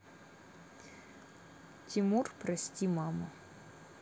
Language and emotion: Russian, neutral